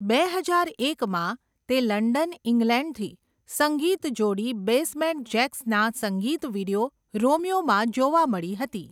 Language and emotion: Gujarati, neutral